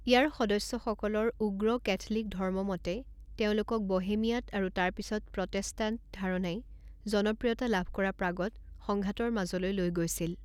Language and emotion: Assamese, neutral